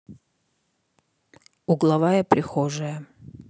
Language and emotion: Russian, neutral